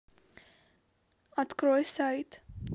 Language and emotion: Russian, neutral